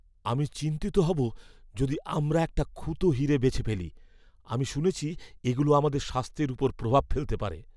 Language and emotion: Bengali, fearful